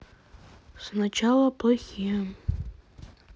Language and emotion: Russian, sad